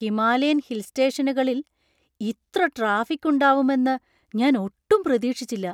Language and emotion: Malayalam, surprised